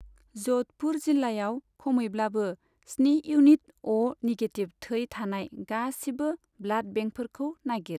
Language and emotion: Bodo, neutral